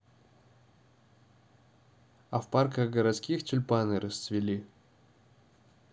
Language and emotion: Russian, neutral